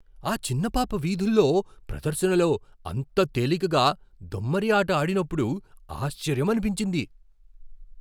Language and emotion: Telugu, surprised